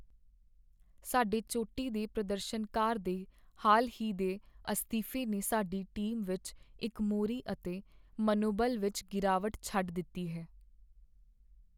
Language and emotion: Punjabi, sad